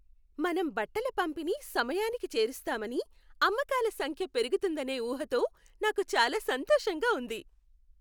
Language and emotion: Telugu, happy